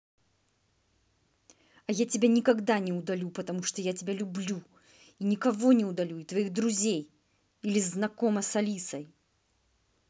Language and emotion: Russian, angry